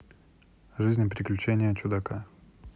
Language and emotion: Russian, neutral